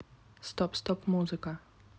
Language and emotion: Russian, neutral